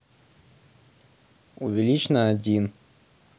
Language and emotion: Russian, neutral